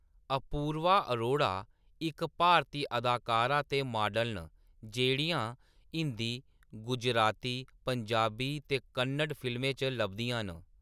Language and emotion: Dogri, neutral